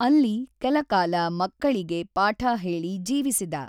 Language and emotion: Kannada, neutral